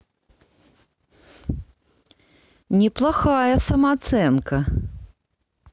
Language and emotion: Russian, neutral